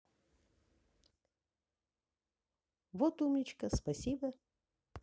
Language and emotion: Russian, positive